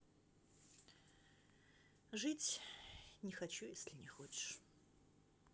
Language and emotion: Russian, sad